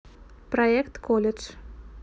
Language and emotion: Russian, neutral